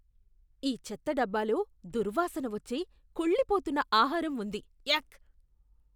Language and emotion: Telugu, disgusted